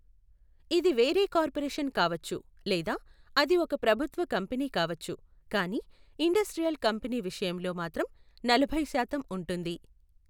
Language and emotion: Telugu, neutral